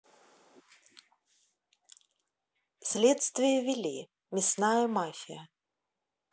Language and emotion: Russian, neutral